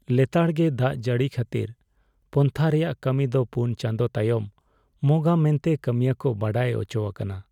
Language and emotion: Santali, sad